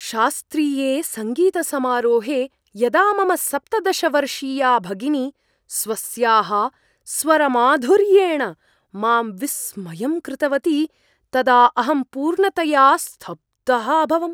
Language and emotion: Sanskrit, surprised